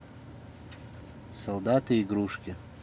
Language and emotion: Russian, neutral